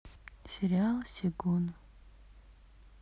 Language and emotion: Russian, sad